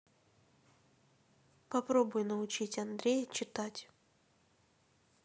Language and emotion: Russian, neutral